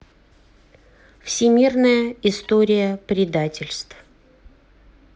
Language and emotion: Russian, neutral